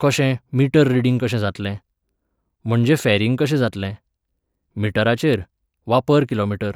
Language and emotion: Goan Konkani, neutral